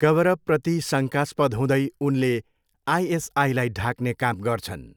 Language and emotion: Nepali, neutral